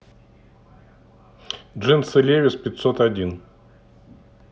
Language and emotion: Russian, neutral